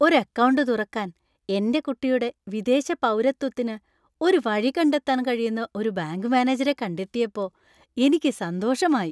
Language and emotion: Malayalam, happy